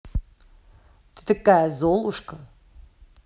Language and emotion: Russian, angry